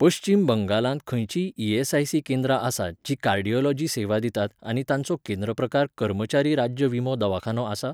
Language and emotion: Goan Konkani, neutral